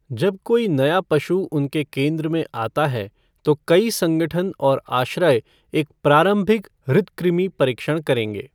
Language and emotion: Hindi, neutral